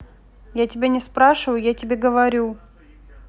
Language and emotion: Russian, neutral